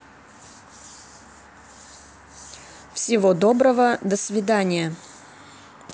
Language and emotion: Russian, neutral